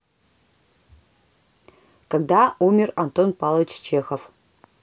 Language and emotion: Russian, neutral